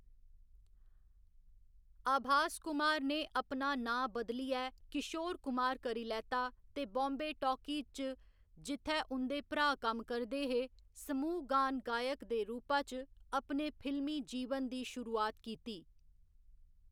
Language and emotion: Dogri, neutral